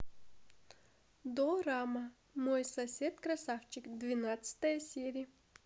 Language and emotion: Russian, positive